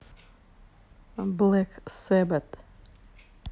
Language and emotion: Russian, neutral